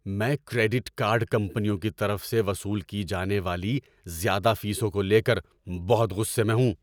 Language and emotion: Urdu, angry